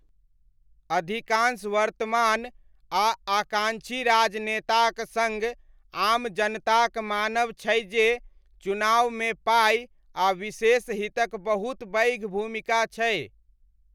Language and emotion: Maithili, neutral